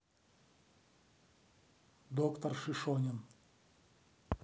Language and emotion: Russian, neutral